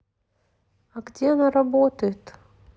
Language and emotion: Russian, neutral